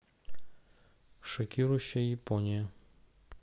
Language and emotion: Russian, neutral